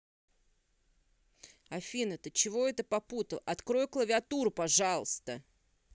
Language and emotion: Russian, angry